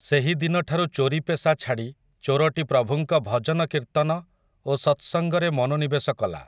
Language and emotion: Odia, neutral